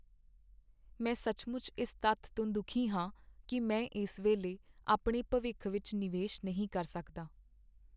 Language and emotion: Punjabi, sad